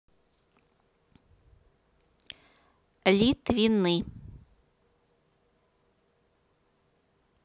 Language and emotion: Russian, neutral